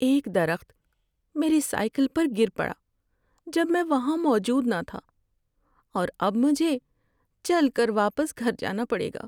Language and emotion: Urdu, sad